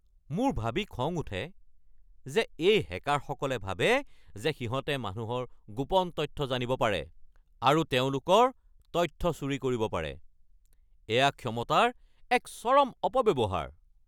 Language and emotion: Assamese, angry